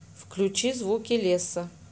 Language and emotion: Russian, neutral